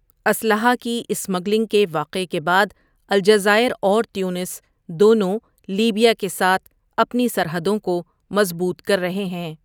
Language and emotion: Urdu, neutral